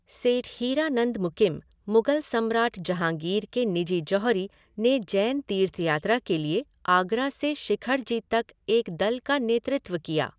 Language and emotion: Hindi, neutral